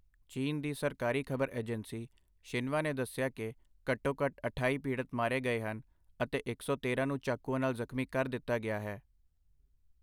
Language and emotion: Punjabi, neutral